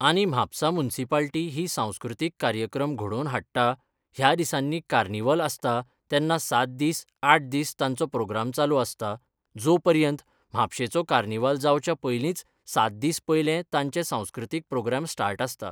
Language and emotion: Goan Konkani, neutral